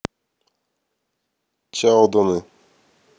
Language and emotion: Russian, neutral